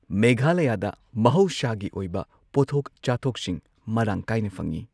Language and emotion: Manipuri, neutral